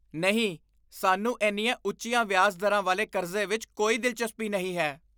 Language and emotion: Punjabi, disgusted